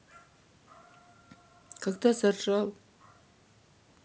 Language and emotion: Russian, neutral